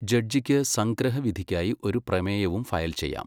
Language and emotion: Malayalam, neutral